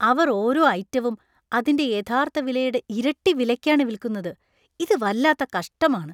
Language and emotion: Malayalam, disgusted